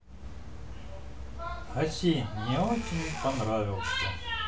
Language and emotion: Russian, neutral